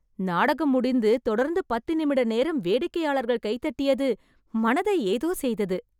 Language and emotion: Tamil, happy